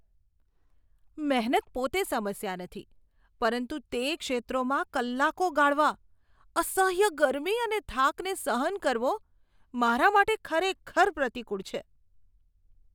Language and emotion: Gujarati, disgusted